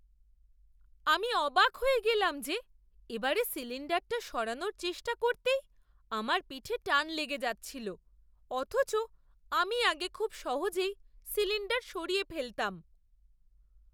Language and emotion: Bengali, surprised